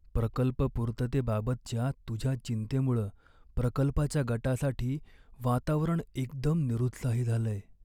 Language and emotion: Marathi, sad